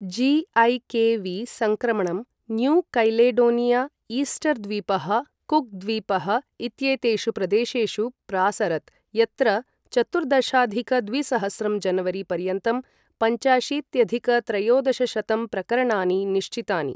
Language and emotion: Sanskrit, neutral